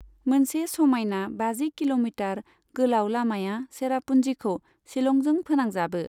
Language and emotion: Bodo, neutral